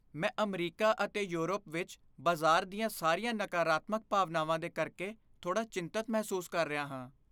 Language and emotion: Punjabi, fearful